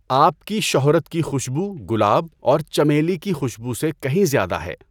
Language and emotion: Urdu, neutral